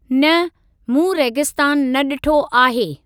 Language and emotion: Sindhi, neutral